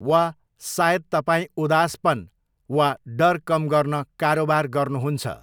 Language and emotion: Nepali, neutral